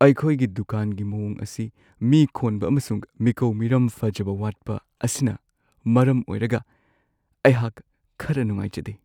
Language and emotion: Manipuri, sad